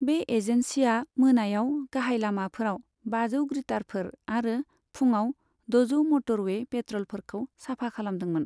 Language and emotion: Bodo, neutral